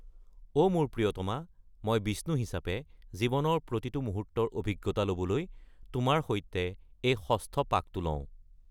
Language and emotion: Assamese, neutral